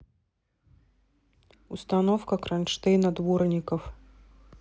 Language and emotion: Russian, neutral